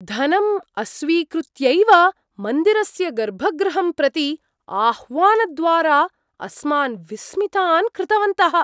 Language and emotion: Sanskrit, surprised